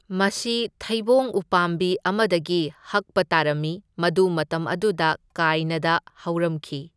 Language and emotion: Manipuri, neutral